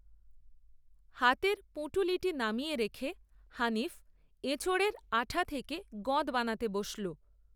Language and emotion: Bengali, neutral